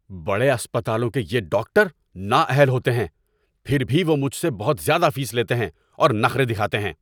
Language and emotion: Urdu, angry